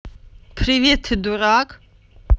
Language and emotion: Russian, angry